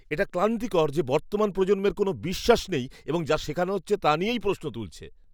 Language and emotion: Bengali, disgusted